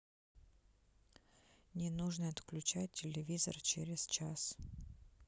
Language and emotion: Russian, neutral